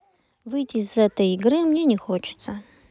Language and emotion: Russian, neutral